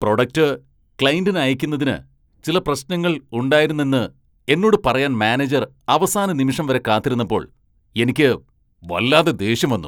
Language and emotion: Malayalam, angry